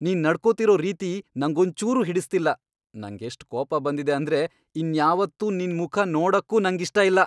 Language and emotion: Kannada, angry